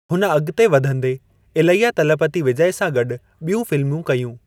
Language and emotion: Sindhi, neutral